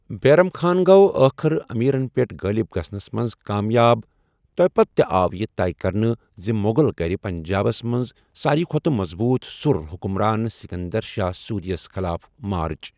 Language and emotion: Kashmiri, neutral